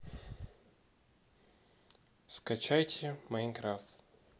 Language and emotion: Russian, neutral